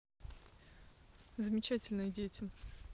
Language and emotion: Russian, neutral